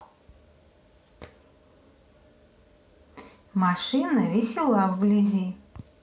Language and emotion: Russian, neutral